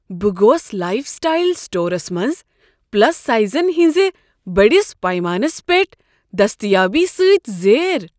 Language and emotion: Kashmiri, surprised